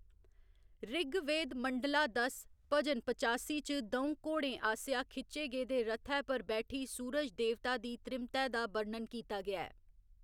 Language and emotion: Dogri, neutral